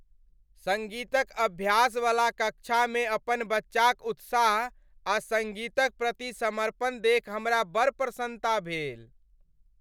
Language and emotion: Maithili, happy